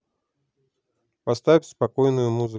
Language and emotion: Russian, neutral